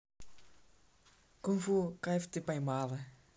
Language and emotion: Russian, positive